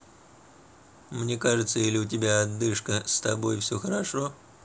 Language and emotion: Russian, neutral